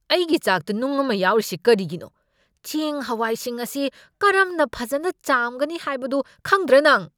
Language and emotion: Manipuri, angry